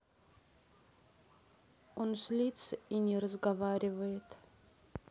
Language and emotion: Russian, sad